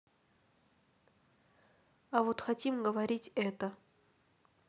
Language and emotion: Russian, neutral